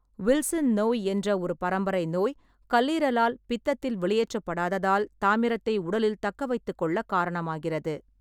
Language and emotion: Tamil, neutral